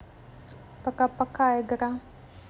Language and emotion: Russian, neutral